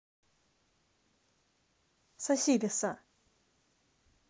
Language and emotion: Russian, neutral